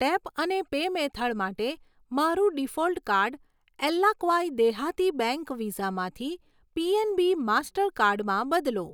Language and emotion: Gujarati, neutral